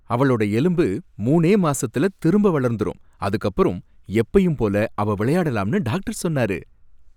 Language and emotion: Tamil, happy